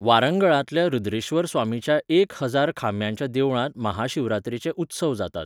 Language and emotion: Goan Konkani, neutral